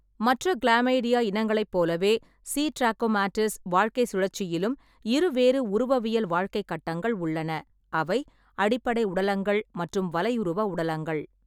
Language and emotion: Tamil, neutral